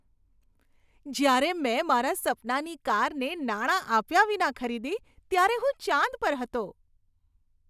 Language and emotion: Gujarati, happy